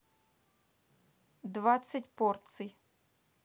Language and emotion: Russian, neutral